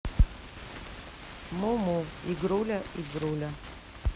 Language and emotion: Russian, neutral